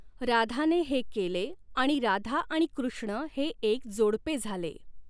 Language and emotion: Marathi, neutral